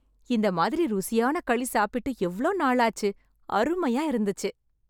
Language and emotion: Tamil, happy